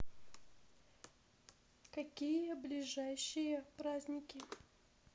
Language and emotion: Russian, neutral